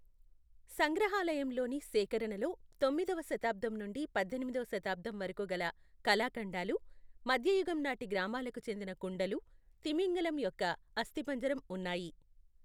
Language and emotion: Telugu, neutral